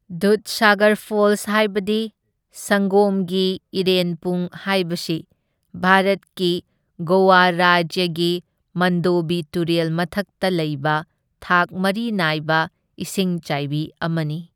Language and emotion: Manipuri, neutral